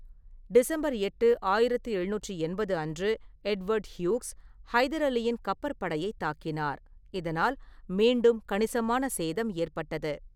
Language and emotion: Tamil, neutral